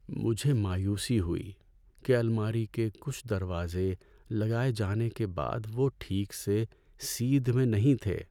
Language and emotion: Urdu, sad